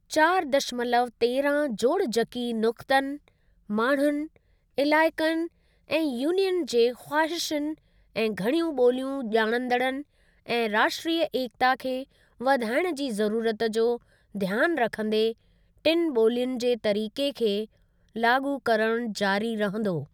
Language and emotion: Sindhi, neutral